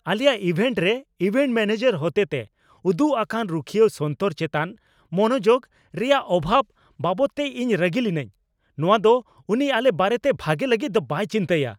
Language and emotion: Santali, angry